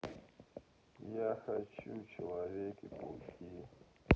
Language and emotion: Russian, sad